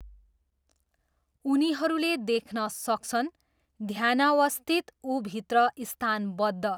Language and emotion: Nepali, neutral